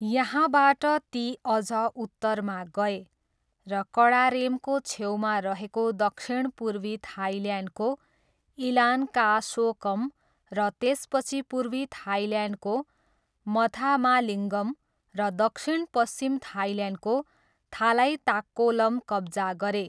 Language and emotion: Nepali, neutral